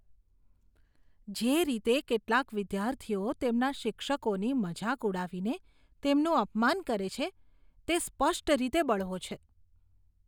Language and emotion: Gujarati, disgusted